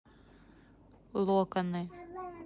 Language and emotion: Russian, neutral